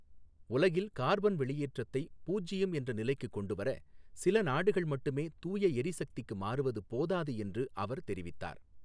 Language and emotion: Tamil, neutral